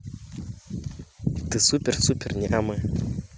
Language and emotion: Russian, positive